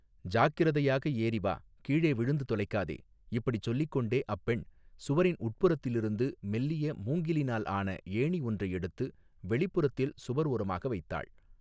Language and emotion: Tamil, neutral